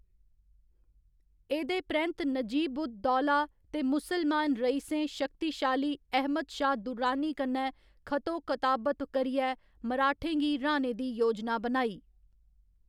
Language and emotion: Dogri, neutral